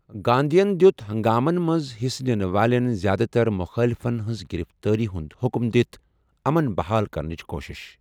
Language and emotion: Kashmiri, neutral